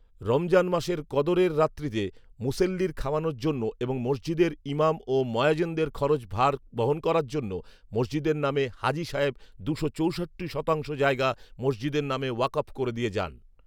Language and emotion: Bengali, neutral